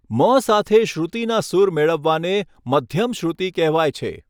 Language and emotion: Gujarati, neutral